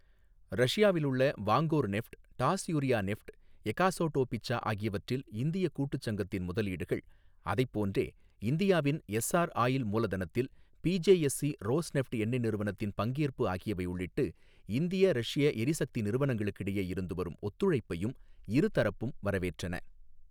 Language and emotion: Tamil, neutral